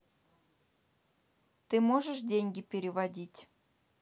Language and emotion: Russian, neutral